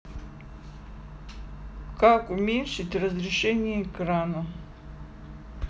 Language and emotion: Russian, neutral